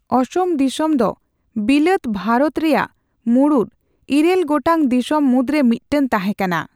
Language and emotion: Santali, neutral